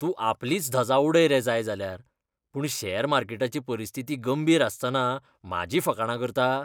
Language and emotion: Goan Konkani, disgusted